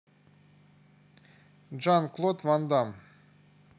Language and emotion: Russian, neutral